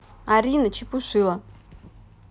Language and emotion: Russian, neutral